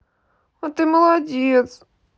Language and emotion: Russian, sad